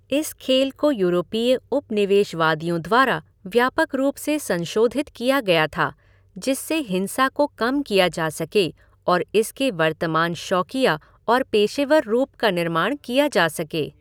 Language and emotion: Hindi, neutral